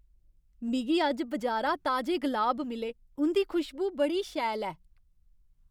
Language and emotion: Dogri, happy